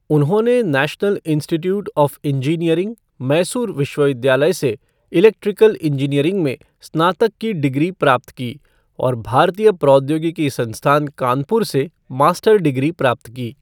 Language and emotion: Hindi, neutral